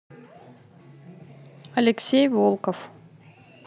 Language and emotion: Russian, neutral